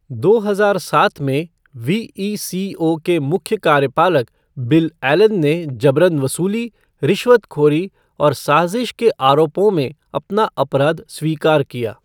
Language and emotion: Hindi, neutral